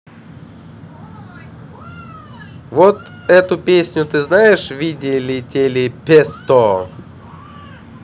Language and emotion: Russian, neutral